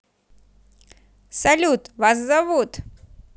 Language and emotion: Russian, positive